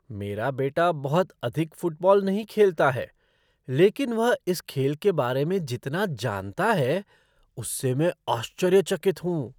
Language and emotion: Hindi, surprised